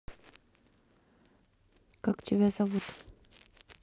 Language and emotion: Russian, neutral